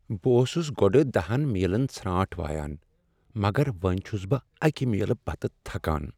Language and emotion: Kashmiri, sad